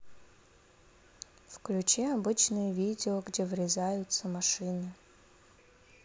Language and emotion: Russian, neutral